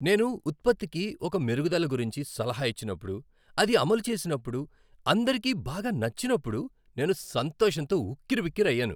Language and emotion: Telugu, happy